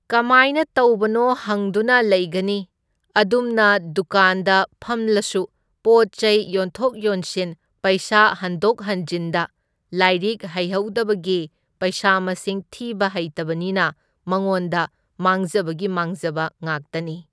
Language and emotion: Manipuri, neutral